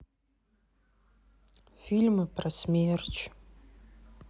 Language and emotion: Russian, sad